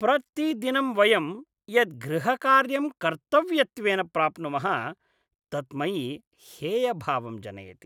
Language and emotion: Sanskrit, disgusted